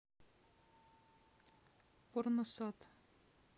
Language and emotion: Russian, neutral